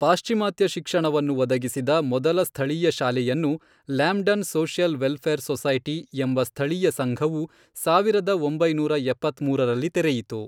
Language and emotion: Kannada, neutral